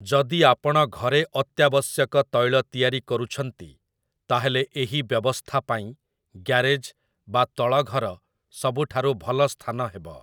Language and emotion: Odia, neutral